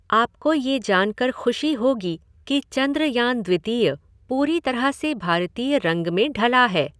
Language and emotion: Hindi, neutral